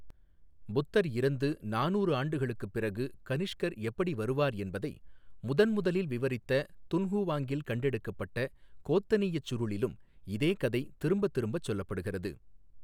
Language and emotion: Tamil, neutral